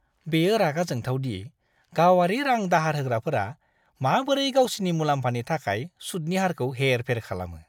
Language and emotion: Bodo, disgusted